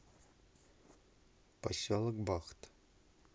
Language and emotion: Russian, neutral